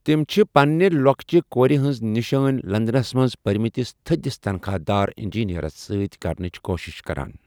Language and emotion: Kashmiri, neutral